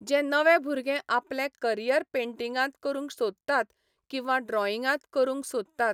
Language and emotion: Goan Konkani, neutral